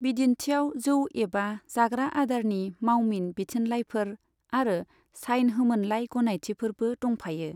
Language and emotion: Bodo, neutral